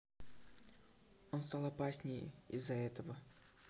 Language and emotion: Russian, neutral